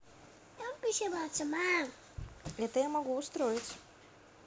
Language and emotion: Russian, positive